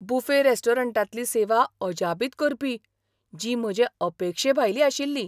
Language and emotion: Goan Konkani, surprised